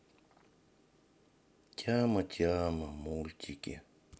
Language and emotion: Russian, sad